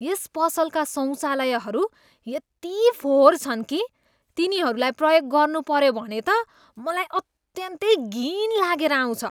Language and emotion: Nepali, disgusted